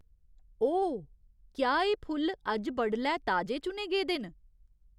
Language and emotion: Dogri, surprised